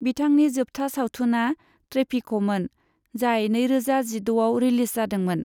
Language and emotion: Bodo, neutral